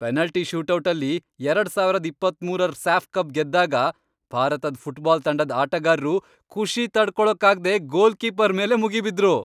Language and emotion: Kannada, happy